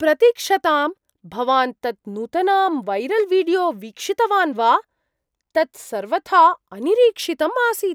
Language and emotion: Sanskrit, surprised